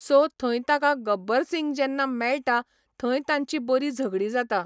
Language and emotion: Goan Konkani, neutral